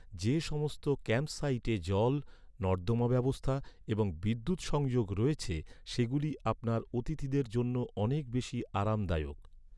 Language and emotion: Bengali, neutral